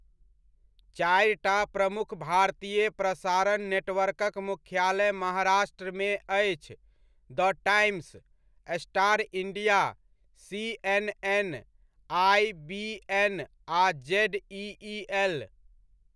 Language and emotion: Maithili, neutral